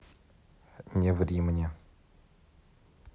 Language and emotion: Russian, neutral